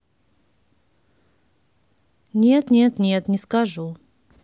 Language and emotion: Russian, neutral